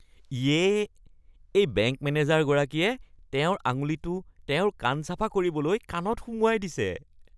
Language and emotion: Assamese, disgusted